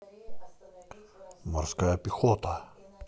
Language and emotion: Russian, neutral